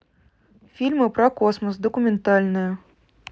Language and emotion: Russian, neutral